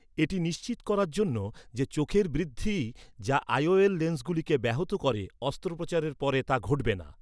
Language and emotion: Bengali, neutral